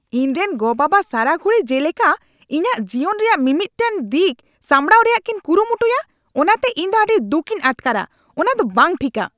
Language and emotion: Santali, angry